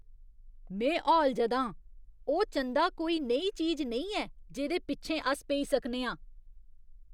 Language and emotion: Dogri, disgusted